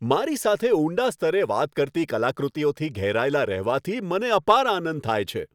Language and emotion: Gujarati, happy